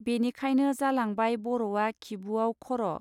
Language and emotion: Bodo, neutral